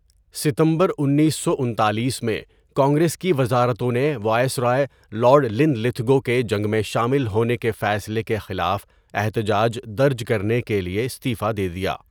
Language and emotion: Urdu, neutral